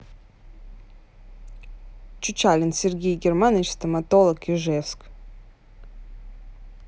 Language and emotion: Russian, neutral